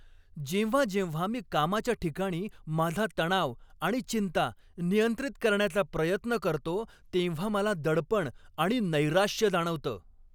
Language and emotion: Marathi, angry